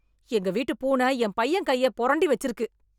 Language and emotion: Tamil, angry